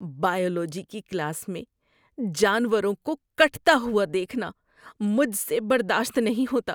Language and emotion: Urdu, disgusted